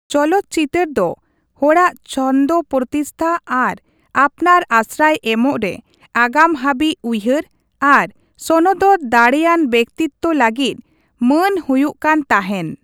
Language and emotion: Santali, neutral